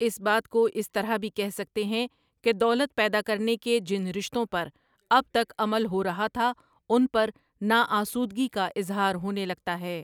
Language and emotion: Urdu, neutral